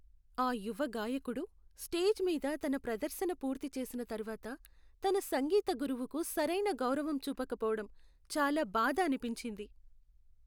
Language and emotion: Telugu, sad